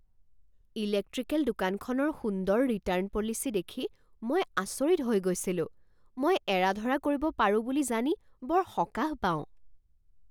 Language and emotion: Assamese, surprised